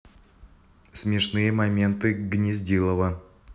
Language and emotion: Russian, neutral